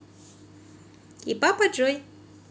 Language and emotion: Russian, positive